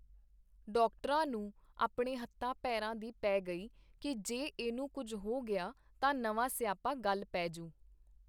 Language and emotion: Punjabi, neutral